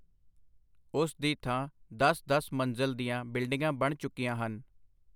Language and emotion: Punjabi, neutral